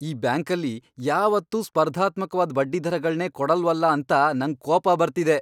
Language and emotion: Kannada, angry